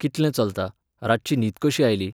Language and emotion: Goan Konkani, neutral